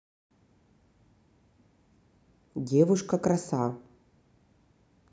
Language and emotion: Russian, neutral